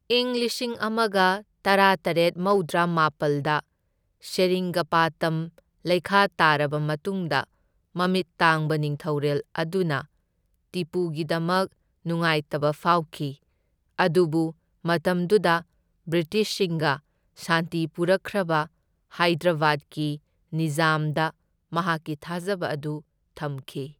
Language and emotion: Manipuri, neutral